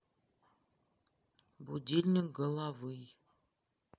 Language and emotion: Russian, neutral